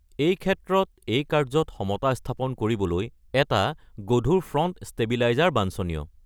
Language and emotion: Assamese, neutral